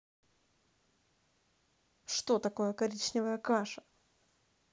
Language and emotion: Russian, angry